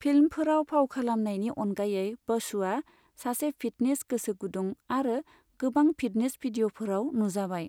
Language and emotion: Bodo, neutral